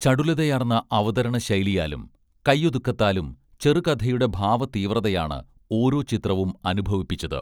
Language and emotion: Malayalam, neutral